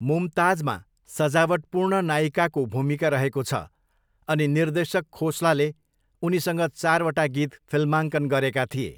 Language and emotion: Nepali, neutral